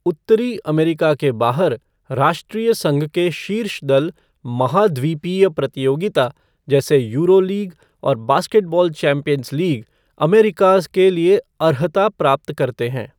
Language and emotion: Hindi, neutral